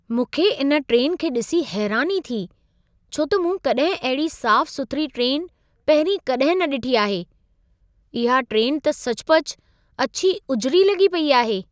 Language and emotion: Sindhi, surprised